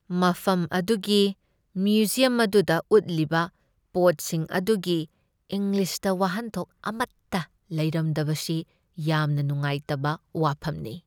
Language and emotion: Manipuri, sad